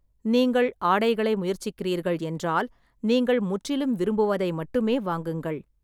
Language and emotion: Tamil, neutral